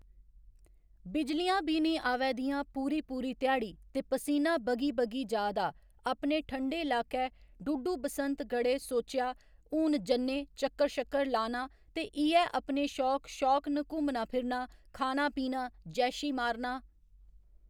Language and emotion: Dogri, neutral